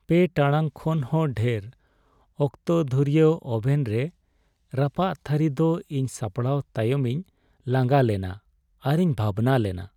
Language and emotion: Santali, sad